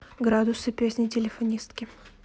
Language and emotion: Russian, neutral